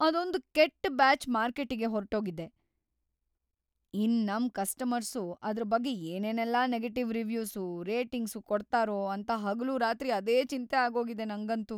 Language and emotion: Kannada, fearful